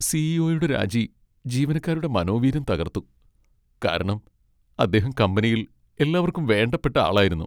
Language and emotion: Malayalam, sad